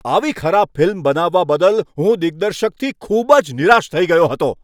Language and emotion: Gujarati, angry